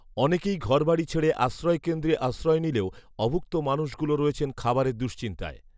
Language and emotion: Bengali, neutral